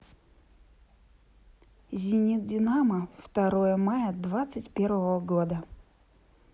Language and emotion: Russian, positive